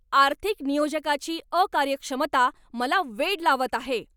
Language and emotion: Marathi, angry